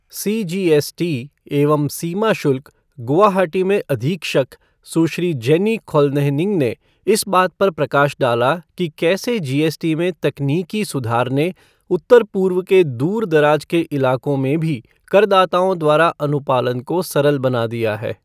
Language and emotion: Hindi, neutral